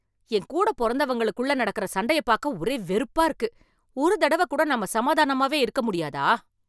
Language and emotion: Tamil, angry